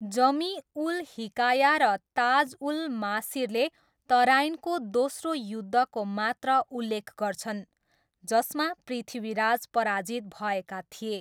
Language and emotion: Nepali, neutral